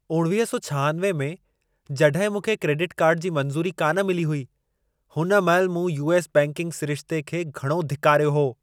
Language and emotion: Sindhi, angry